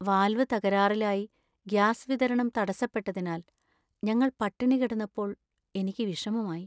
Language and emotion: Malayalam, sad